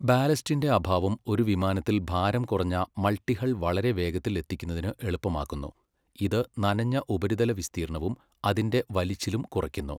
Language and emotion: Malayalam, neutral